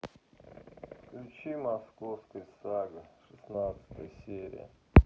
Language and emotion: Russian, sad